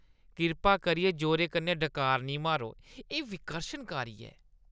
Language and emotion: Dogri, disgusted